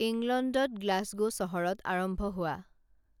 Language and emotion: Assamese, neutral